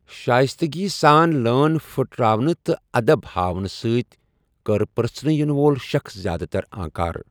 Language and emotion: Kashmiri, neutral